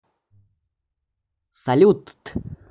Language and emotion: Russian, positive